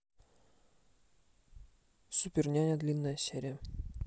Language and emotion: Russian, neutral